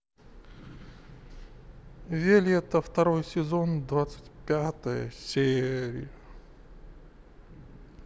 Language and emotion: Russian, neutral